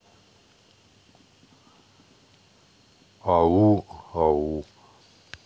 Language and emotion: Russian, sad